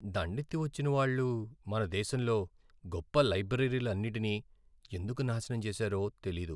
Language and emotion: Telugu, sad